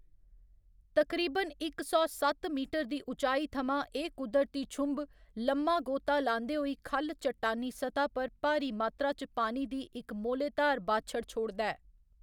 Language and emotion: Dogri, neutral